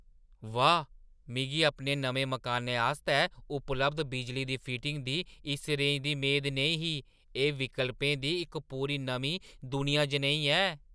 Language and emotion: Dogri, surprised